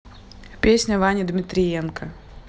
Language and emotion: Russian, neutral